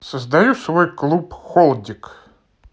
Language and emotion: Russian, neutral